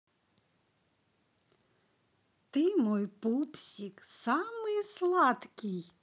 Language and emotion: Russian, positive